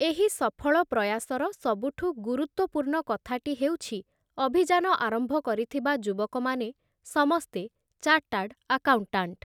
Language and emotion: Odia, neutral